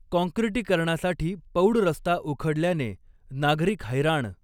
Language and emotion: Marathi, neutral